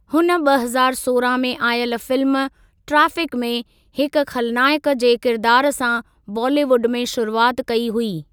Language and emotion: Sindhi, neutral